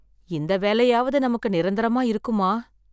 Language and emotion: Tamil, fearful